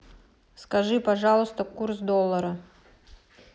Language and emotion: Russian, neutral